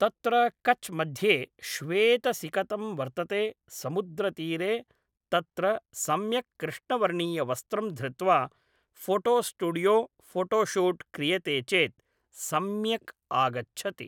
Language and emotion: Sanskrit, neutral